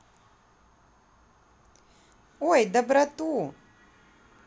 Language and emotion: Russian, positive